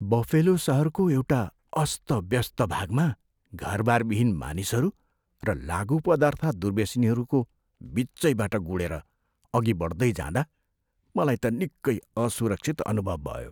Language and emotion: Nepali, fearful